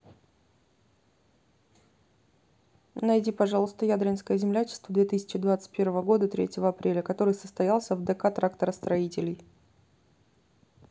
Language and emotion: Russian, neutral